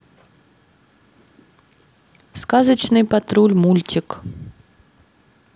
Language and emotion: Russian, neutral